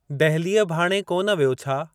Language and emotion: Sindhi, neutral